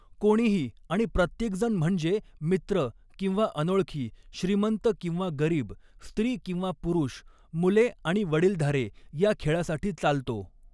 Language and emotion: Marathi, neutral